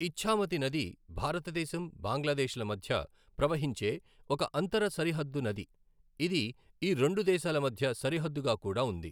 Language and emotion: Telugu, neutral